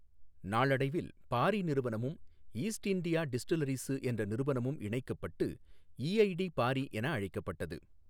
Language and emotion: Tamil, neutral